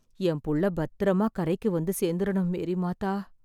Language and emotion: Tamil, sad